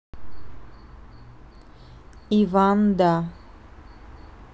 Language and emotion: Russian, neutral